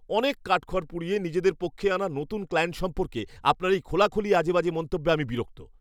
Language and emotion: Bengali, angry